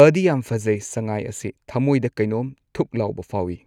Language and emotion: Manipuri, neutral